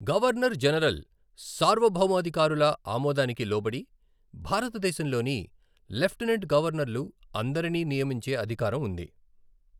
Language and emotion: Telugu, neutral